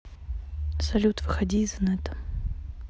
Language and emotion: Russian, neutral